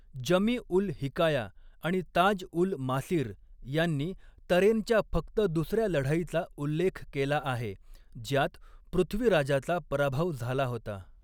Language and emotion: Marathi, neutral